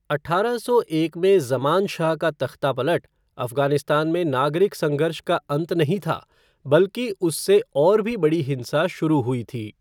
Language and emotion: Hindi, neutral